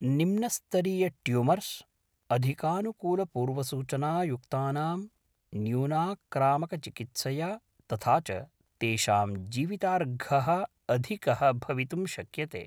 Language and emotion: Sanskrit, neutral